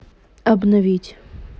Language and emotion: Russian, neutral